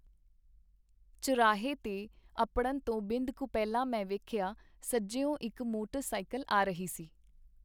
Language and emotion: Punjabi, neutral